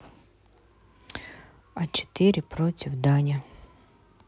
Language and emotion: Russian, neutral